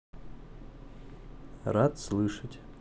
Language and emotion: Russian, neutral